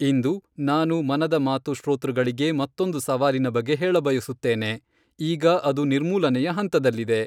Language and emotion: Kannada, neutral